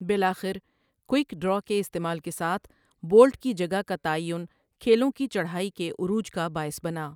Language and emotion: Urdu, neutral